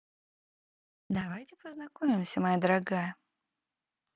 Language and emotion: Russian, positive